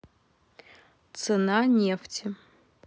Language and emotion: Russian, neutral